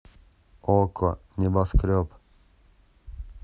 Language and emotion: Russian, neutral